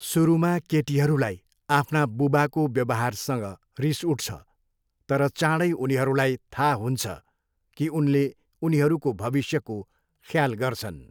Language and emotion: Nepali, neutral